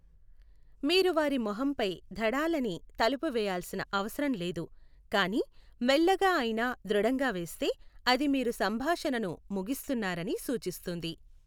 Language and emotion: Telugu, neutral